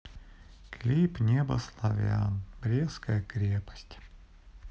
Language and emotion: Russian, sad